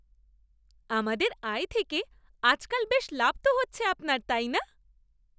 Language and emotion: Bengali, happy